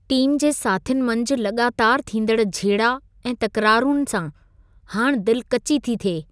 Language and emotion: Sindhi, disgusted